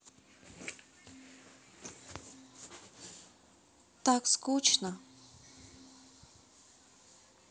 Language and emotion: Russian, sad